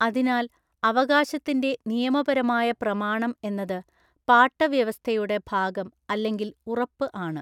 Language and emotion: Malayalam, neutral